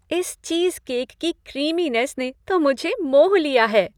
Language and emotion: Hindi, happy